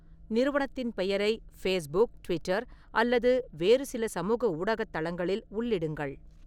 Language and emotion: Tamil, neutral